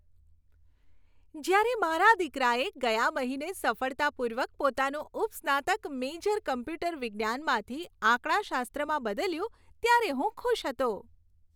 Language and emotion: Gujarati, happy